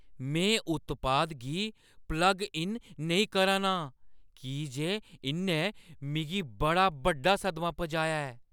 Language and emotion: Dogri, fearful